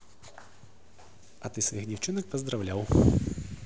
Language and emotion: Russian, positive